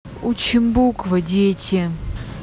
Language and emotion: Russian, angry